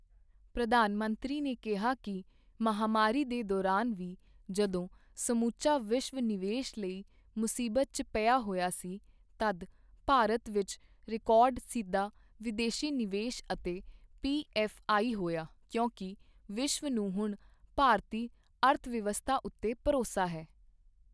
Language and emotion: Punjabi, neutral